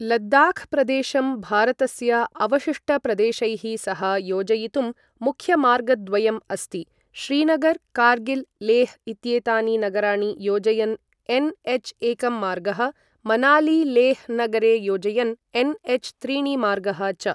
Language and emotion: Sanskrit, neutral